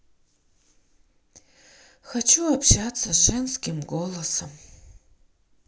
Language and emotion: Russian, sad